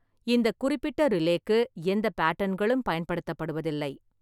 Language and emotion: Tamil, neutral